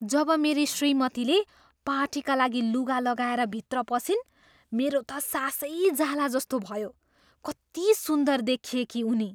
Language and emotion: Nepali, surprised